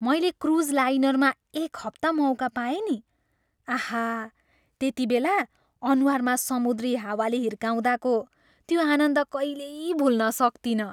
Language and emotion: Nepali, happy